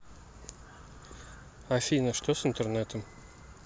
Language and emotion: Russian, neutral